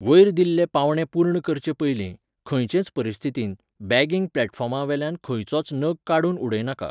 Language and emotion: Goan Konkani, neutral